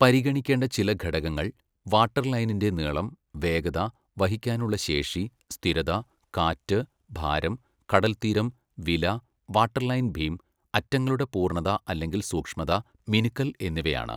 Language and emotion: Malayalam, neutral